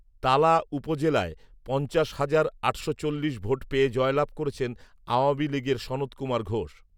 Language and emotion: Bengali, neutral